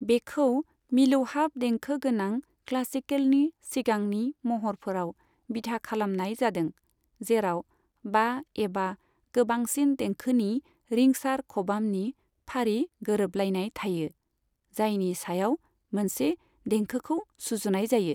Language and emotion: Bodo, neutral